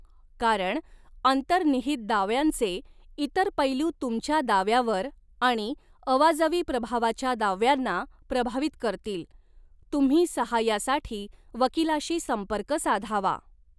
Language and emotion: Marathi, neutral